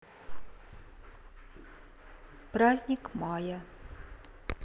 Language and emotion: Russian, neutral